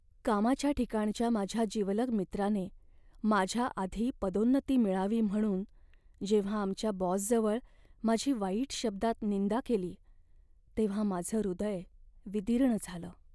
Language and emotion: Marathi, sad